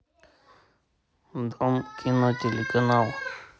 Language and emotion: Russian, neutral